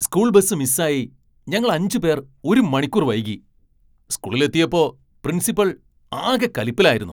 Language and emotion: Malayalam, angry